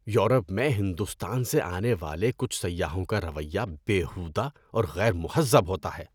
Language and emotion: Urdu, disgusted